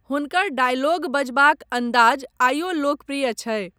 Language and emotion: Maithili, neutral